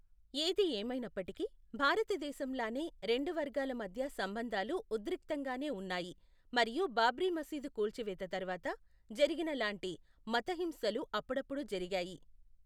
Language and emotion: Telugu, neutral